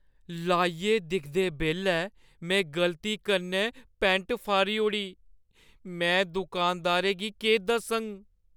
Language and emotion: Dogri, fearful